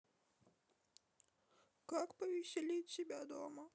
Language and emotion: Russian, sad